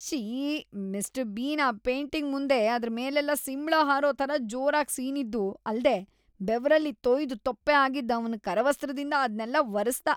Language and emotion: Kannada, disgusted